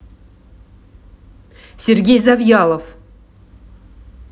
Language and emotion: Russian, angry